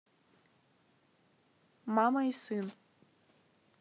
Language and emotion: Russian, neutral